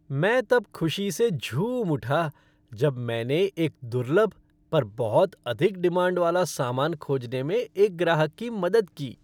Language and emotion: Hindi, happy